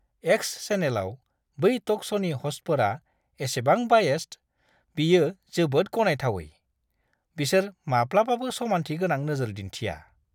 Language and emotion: Bodo, disgusted